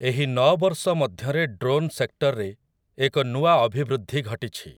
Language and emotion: Odia, neutral